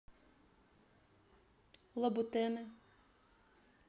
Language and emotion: Russian, neutral